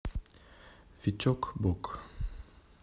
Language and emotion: Russian, neutral